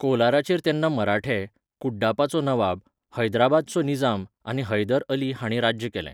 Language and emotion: Goan Konkani, neutral